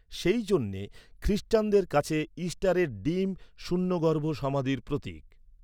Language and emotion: Bengali, neutral